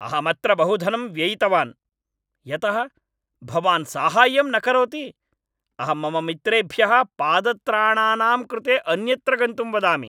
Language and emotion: Sanskrit, angry